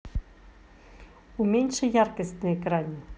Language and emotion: Russian, neutral